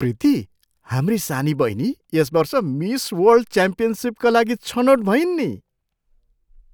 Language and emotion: Nepali, surprised